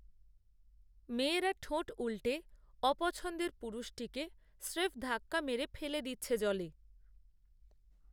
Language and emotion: Bengali, neutral